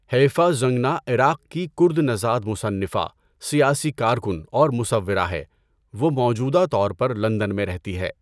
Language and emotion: Urdu, neutral